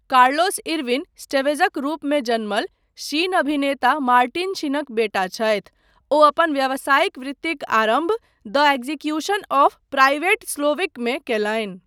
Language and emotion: Maithili, neutral